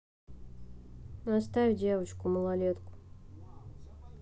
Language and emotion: Russian, neutral